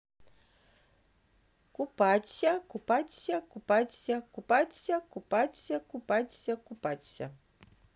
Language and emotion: Russian, neutral